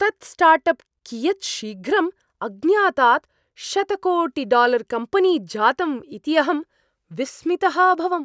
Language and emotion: Sanskrit, surprised